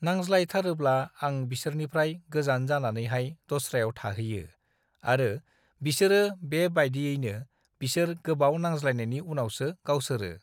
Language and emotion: Bodo, neutral